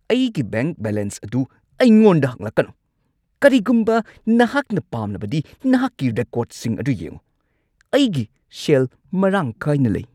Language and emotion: Manipuri, angry